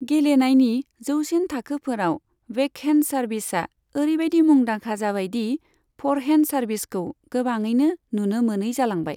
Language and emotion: Bodo, neutral